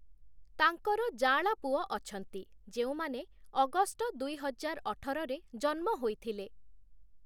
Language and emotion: Odia, neutral